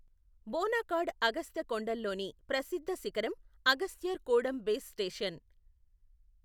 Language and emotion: Telugu, neutral